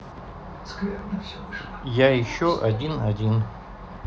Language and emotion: Russian, neutral